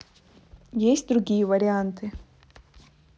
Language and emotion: Russian, neutral